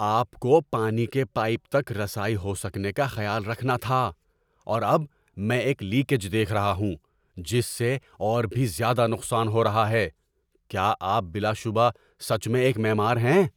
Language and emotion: Urdu, angry